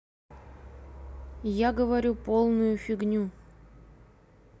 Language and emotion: Russian, neutral